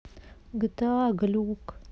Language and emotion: Russian, sad